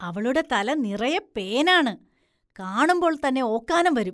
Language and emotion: Malayalam, disgusted